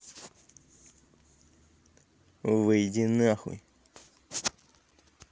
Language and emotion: Russian, angry